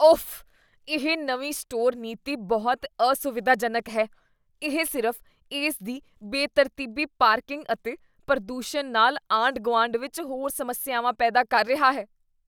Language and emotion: Punjabi, disgusted